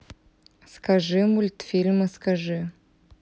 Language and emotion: Russian, neutral